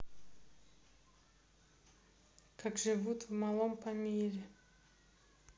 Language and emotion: Russian, neutral